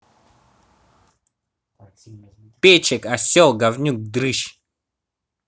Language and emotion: Russian, angry